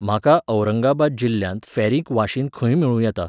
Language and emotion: Goan Konkani, neutral